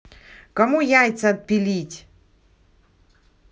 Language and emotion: Russian, angry